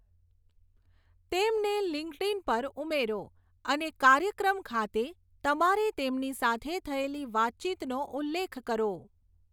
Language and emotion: Gujarati, neutral